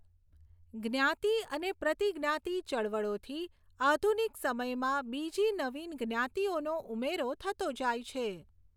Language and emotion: Gujarati, neutral